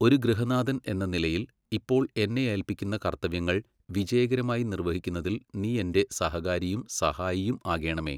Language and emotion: Malayalam, neutral